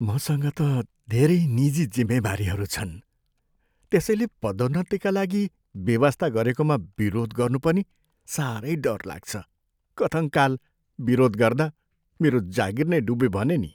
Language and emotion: Nepali, fearful